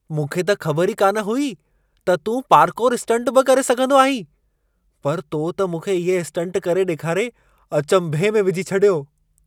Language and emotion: Sindhi, surprised